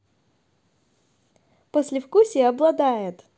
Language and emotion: Russian, positive